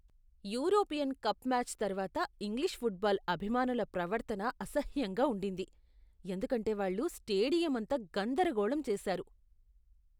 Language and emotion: Telugu, disgusted